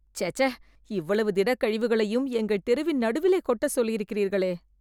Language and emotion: Tamil, disgusted